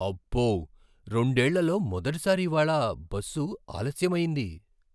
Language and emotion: Telugu, surprised